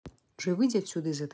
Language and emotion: Russian, angry